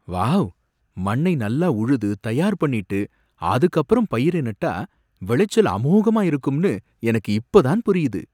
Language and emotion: Tamil, surprised